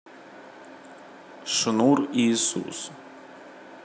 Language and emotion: Russian, neutral